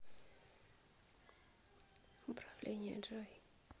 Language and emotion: Russian, neutral